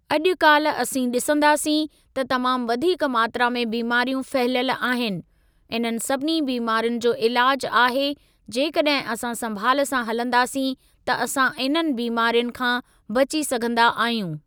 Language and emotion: Sindhi, neutral